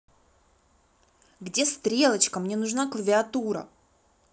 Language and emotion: Russian, angry